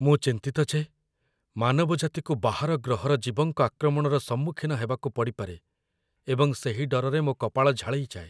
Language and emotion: Odia, fearful